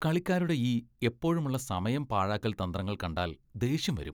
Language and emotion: Malayalam, disgusted